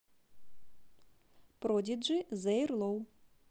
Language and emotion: Russian, positive